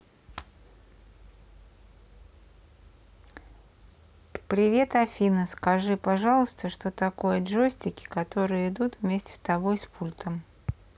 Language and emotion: Russian, neutral